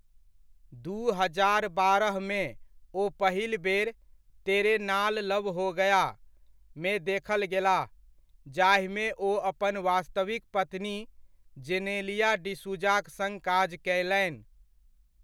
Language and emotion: Maithili, neutral